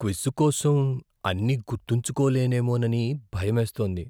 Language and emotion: Telugu, fearful